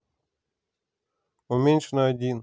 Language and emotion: Russian, neutral